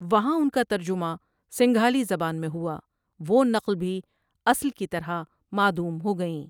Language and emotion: Urdu, neutral